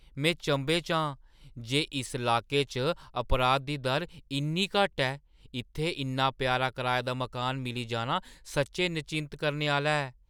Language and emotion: Dogri, surprised